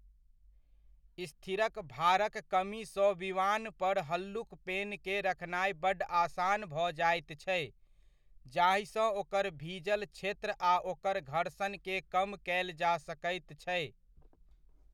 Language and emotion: Maithili, neutral